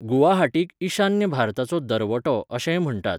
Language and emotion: Goan Konkani, neutral